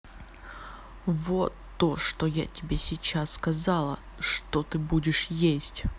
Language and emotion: Russian, angry